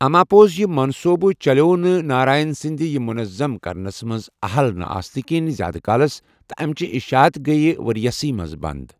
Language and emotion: Kashmiri, neutral